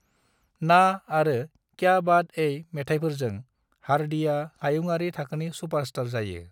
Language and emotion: Bodo, neutral